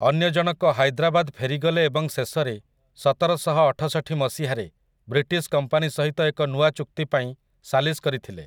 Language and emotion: Odia, neutral